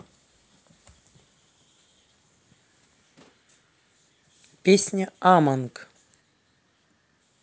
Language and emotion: Russian, neutral